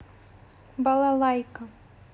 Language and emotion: Russian, neutral